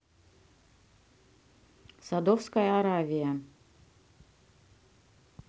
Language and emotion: Russian, neutral